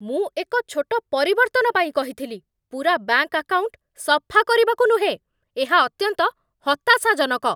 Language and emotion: Odia, angry